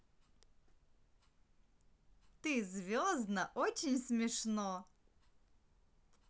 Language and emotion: Russian, positive